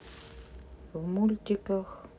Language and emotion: Russian, neutral